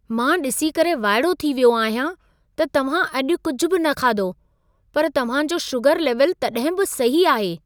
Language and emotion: Sindhi, surprised